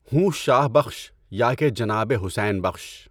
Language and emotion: Urdu, neutral